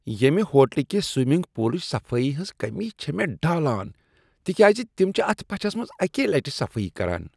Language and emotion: Kashmiri, disgusted